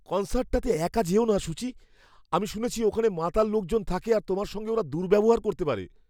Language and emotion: Bengali, fearful